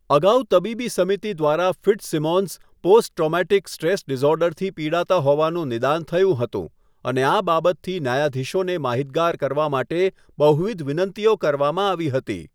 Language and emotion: Gujarati, neutral